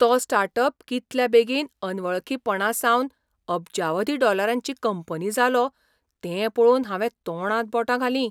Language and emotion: Goan Konkani, surprised